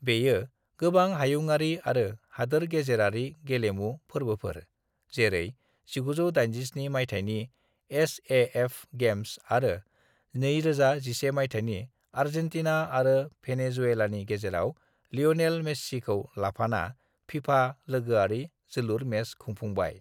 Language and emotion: Bodo, neutral